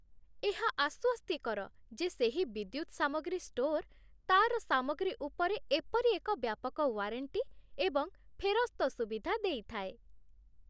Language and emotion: Odia, happy